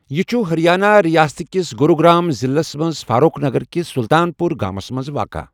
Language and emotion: Kashmiri, neutral